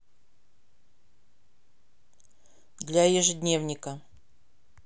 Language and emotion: Russian, neutral